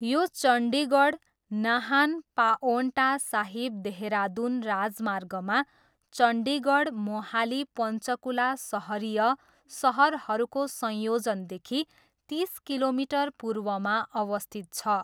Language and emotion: Nepali, neutral